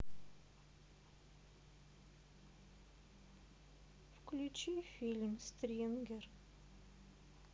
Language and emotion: Russian, sad